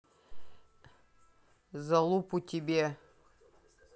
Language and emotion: Russian, neutral